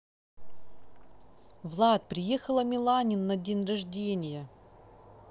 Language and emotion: Russian, neutral